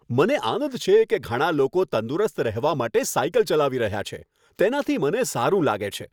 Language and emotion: Gujarati, happy